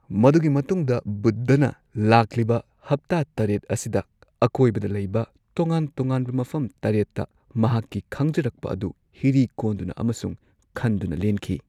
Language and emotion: Manipuri, neutral